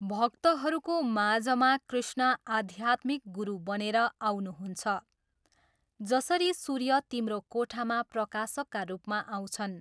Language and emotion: Nepali, neutral